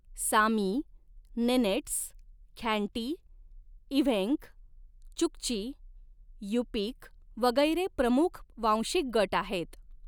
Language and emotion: Marathi, neutral